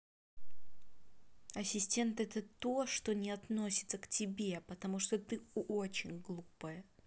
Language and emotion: Russian, angry